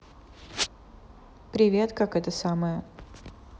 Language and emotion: Russian, neutral